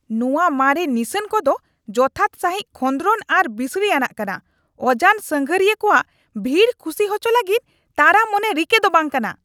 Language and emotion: Santali, angry